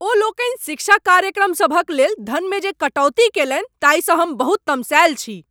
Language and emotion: Maithili, angry